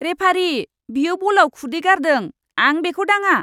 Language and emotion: Bodo, disgusted